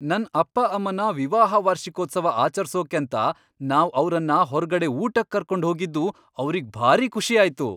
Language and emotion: Kannada, happy